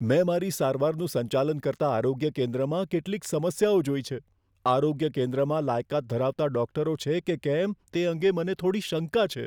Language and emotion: Gujarati, fearful